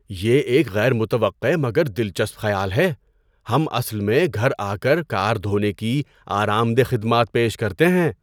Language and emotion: Urdu, surprised